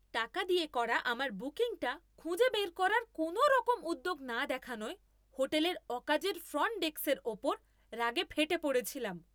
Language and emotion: Bengali, angry